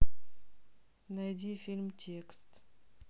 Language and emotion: Russian, neutral